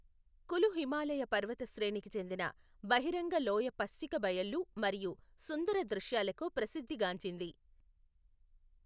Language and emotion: Telugu, neutral